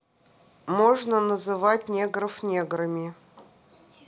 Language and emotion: Russian, neutral